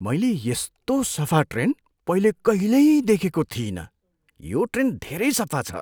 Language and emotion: Nepali, surprised